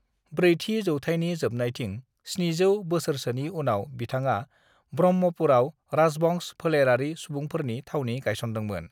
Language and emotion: Bodo, neutral